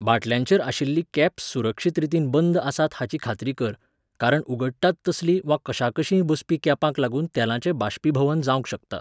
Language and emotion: Goan Konkani, neutral